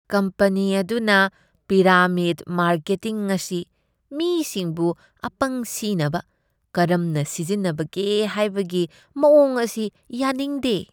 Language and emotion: Manipuri, disgusted